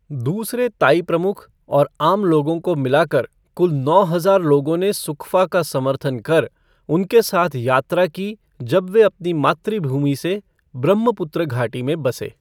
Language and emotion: Hindi, neutral